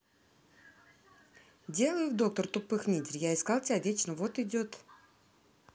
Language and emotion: Russian, neutral